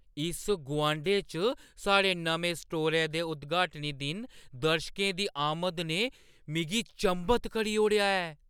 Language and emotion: Dogri, surprised